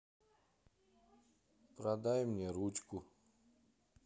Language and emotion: Russian, sad